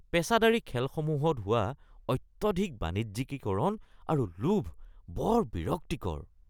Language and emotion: Assamese, disgusted